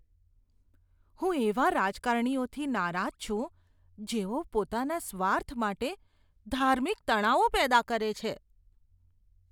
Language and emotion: Gujarati, disgusted